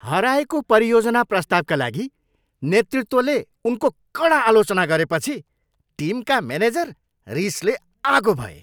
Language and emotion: Nepali, angry